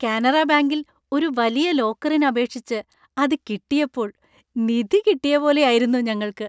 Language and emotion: Malayalam, happy